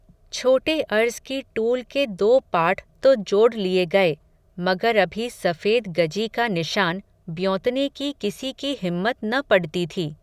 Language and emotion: Hindi, neutral